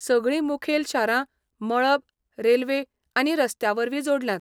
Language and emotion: Goan Konkani, neutral